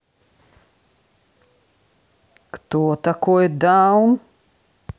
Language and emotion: Russian, neutral